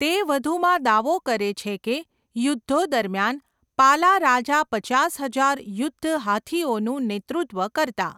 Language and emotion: Gujarati, neutral